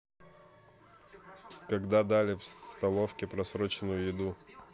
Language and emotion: Russian, neutral